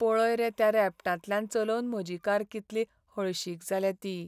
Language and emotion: Goan Konkani, sad